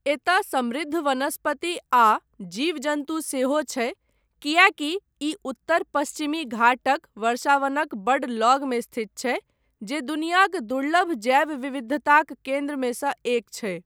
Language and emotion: Maithili, neutral